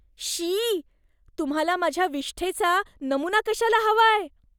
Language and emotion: Marathi, disgusted